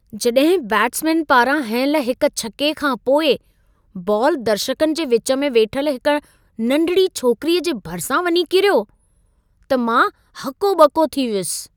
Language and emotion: Sindhi, surprised